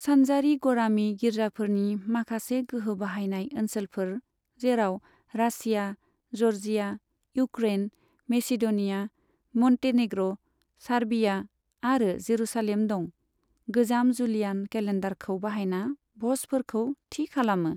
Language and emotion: Bodo, neutral